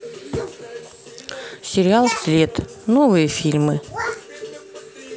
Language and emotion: Russian, neutral